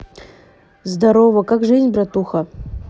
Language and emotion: Russian, neutral